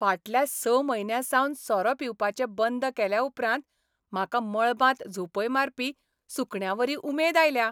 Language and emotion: Goan Konkani, happy